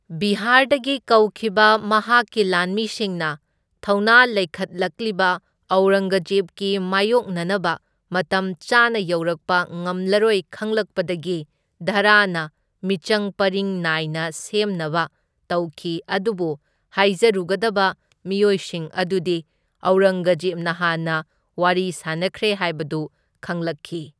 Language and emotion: Manipuri, neutral